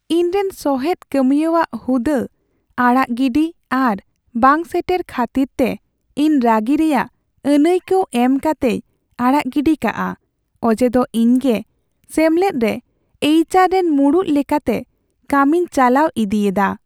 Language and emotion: Santali, sad